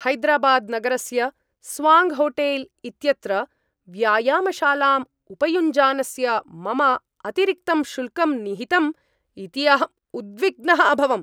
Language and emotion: Sanskrit, angry